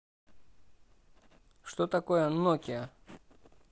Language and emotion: Russian, neutral